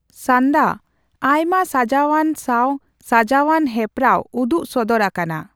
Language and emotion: Santali, neutral